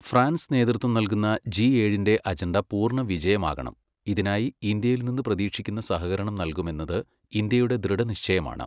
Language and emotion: Malayalam, neutral